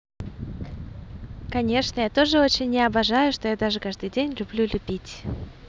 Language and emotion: Russian, positive